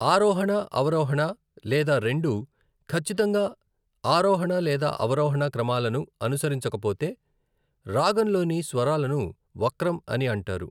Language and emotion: Telugu, neutral